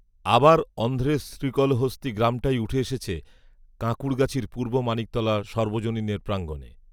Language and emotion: Bengali, neutral